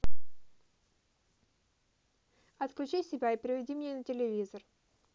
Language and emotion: Russian, neutral